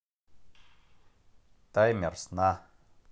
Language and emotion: Russian, neutral